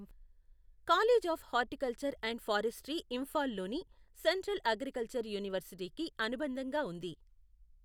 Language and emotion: Telugu, neutral